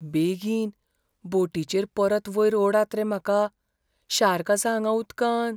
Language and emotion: Goan Konkani, fearful